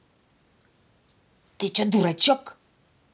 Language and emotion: Russian, angry